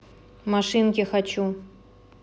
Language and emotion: Russian, neutral